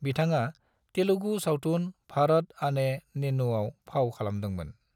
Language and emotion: Bodo, neutral